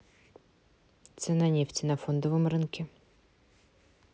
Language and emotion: Russian, neutral